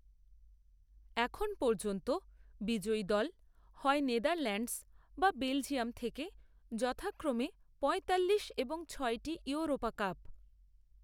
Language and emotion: Bengali, neutral